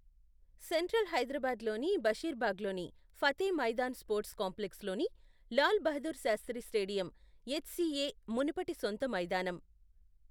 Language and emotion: Telugu, neutral